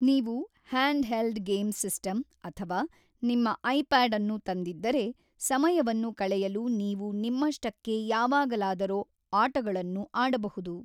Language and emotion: Kannada, neutral